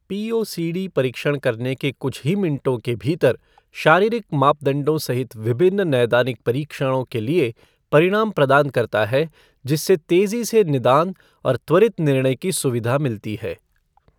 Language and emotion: Hindi, neutral